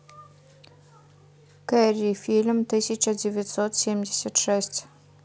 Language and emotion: Russian, neutral